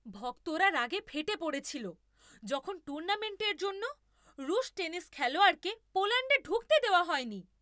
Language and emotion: Bengali, angry